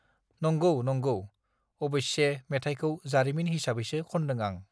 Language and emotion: Bodo, neutral